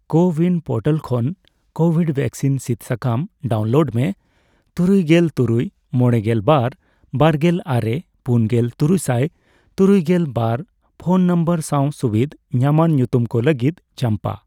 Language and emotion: Santali, neutral